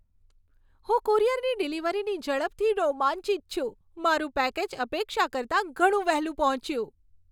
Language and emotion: Gujarati, happy